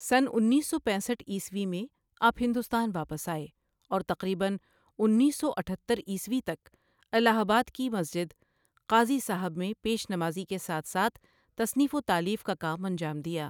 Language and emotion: Urdu, neutral